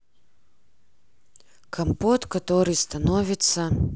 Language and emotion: Russian, neutral